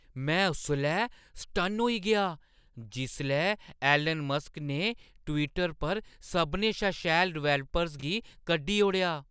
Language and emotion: Dogri, surprised